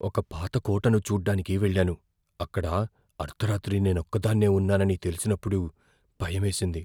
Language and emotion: Telugu, fearful